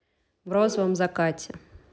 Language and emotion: Russian, neutral